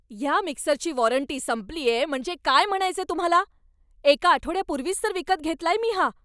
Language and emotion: Marathi, angry